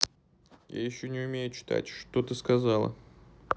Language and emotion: Russian, neutral